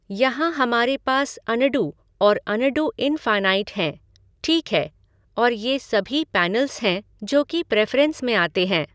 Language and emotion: Hindi, neutral